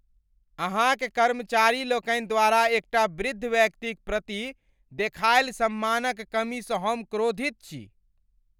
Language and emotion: Maithili, angry